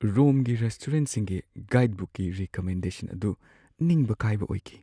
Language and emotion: Manipuri, sad